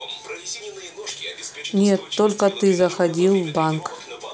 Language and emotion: Russian, neutral